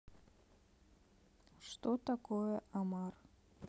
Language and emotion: Russian, neutral